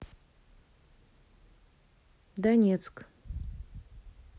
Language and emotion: Russian, neutral